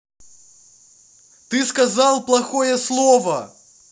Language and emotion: Russian, angry